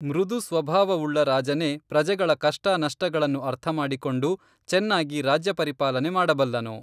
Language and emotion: Kannada, neutral